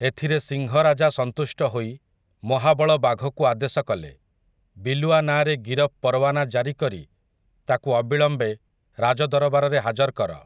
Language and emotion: Odia, neutral